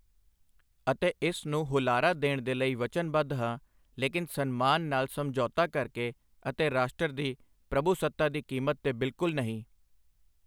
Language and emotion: Punjabi, neutral